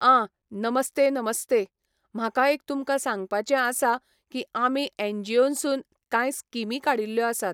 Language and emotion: Goan Konkani, neutral